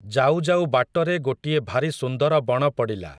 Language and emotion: Odia, neutral